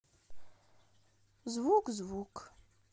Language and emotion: Russian, sad